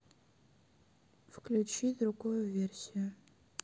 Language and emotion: Russian, sad